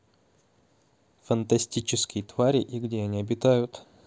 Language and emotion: Russian, neutral